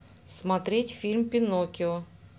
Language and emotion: Russian, neutral